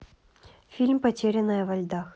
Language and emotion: Russian, neutral